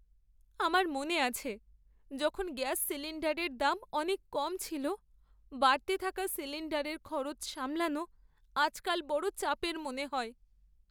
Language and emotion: Bengali, sad